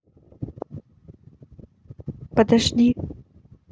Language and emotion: Russian, neutral